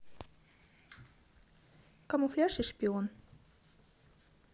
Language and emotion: Russian, neutral